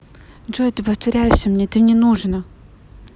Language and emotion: Russian, angry